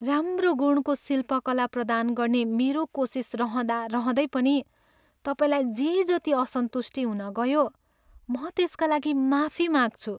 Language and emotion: Nepali, sad